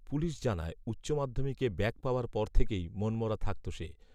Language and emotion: Bengali, neutral